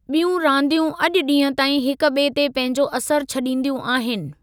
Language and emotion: Sindhi, neutral